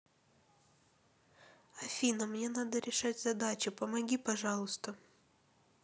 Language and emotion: Russian, sad